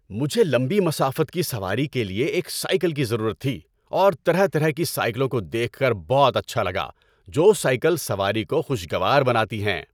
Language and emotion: Urdu, happy